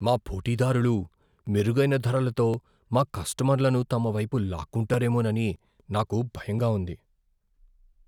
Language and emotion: Telugu, fearful